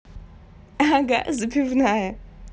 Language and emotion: Russian, positive